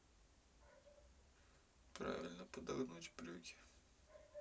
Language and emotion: Russian, sad